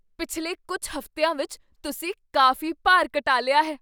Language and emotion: Punjabi, surprised